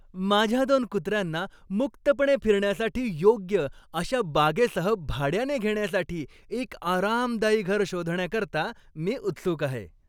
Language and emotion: Marathi, happy